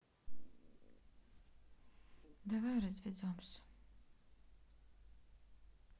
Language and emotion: Russian, sad